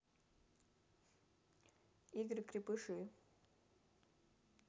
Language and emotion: Russian, neutral